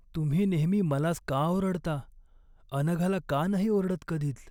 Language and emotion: Marathi, sad